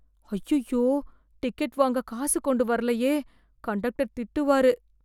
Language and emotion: Tamil, fearful